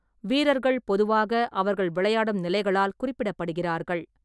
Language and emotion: Tamil, neutral